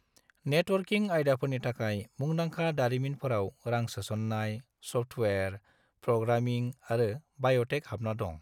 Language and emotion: Bodo, neutral